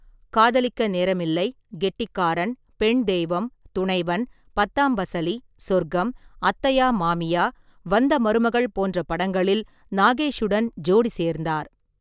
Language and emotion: Tamil, neutral